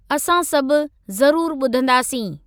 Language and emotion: Sindhi, neutral